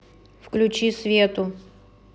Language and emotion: Russian, neutral